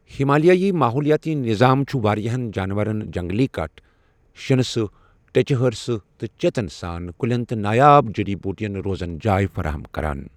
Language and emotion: Kashmiri, neutral